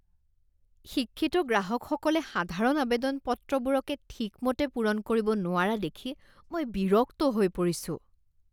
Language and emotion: Assamese, disgusted